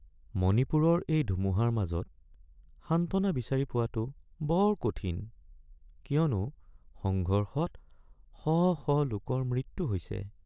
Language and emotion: Assamese, sad